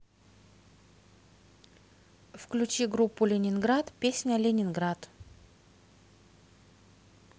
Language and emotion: Russian, neutral